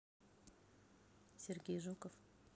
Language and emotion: Russian, neutral